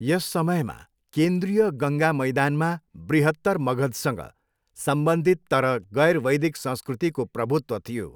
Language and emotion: Nepali, neutral